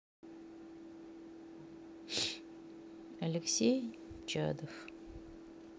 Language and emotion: Russian, sad